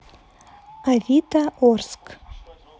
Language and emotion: Russian, neutral